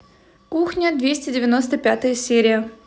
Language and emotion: Russian, positive